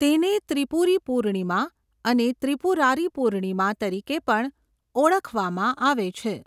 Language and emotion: Gujarati, neutral